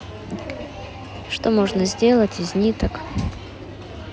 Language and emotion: Russian, neutral